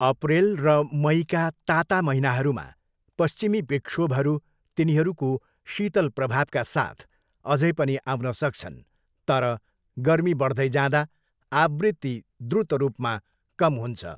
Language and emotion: Nepali, neutral